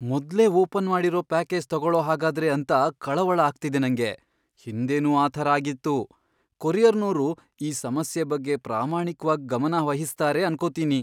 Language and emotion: Kannada, fearful